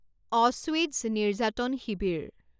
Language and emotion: Assamese, neutral